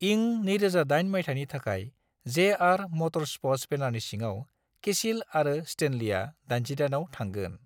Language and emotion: Bodo, neutral